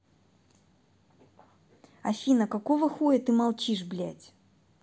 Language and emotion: Russian, angry